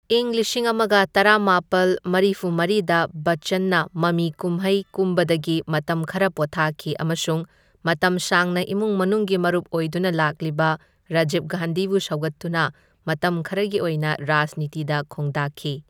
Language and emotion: Manipuri, neutral